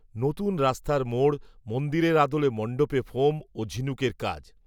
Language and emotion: Bengali, neutral